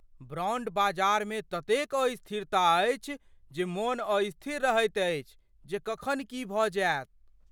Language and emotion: Maithili, fearful